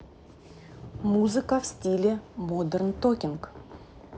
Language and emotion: Russian, neutral